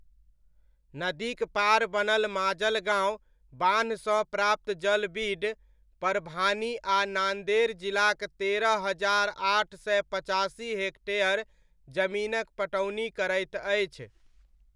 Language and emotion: Maithili, neutral